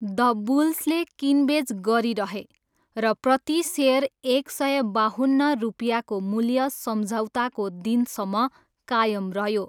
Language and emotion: Nepali, neutral